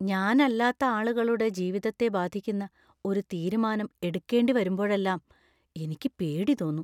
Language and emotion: Malayalam, fearful